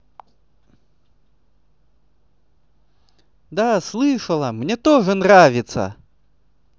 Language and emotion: Russian, positive